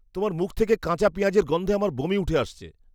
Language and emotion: Bengali, disgusted